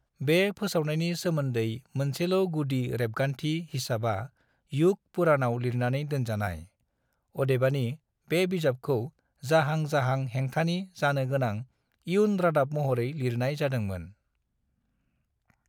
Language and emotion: Bodo, neutral